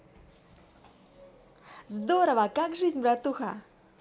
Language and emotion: Russian, positive